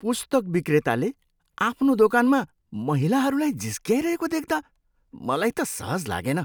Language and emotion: Nepali, disgusted